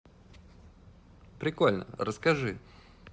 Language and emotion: Russian, positive